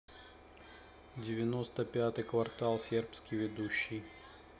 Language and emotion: Russian, neutral